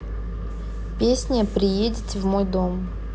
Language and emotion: Russian, neutral